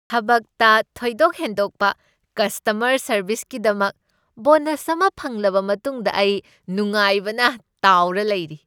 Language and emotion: Manipuri, happy